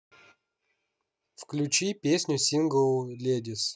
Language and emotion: Russian, neutral